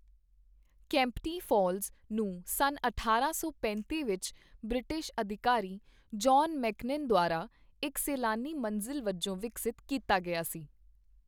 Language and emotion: Punjabi, neutral